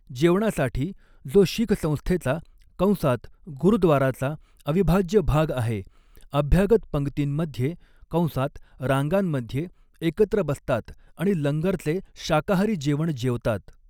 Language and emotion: Marathi, neutral